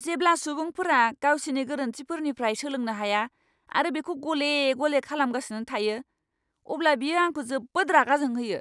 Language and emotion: Bodo, angry